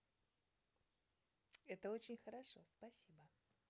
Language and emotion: Russian, positive